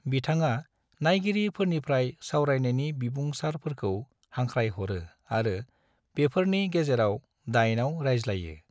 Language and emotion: Bodo, neutral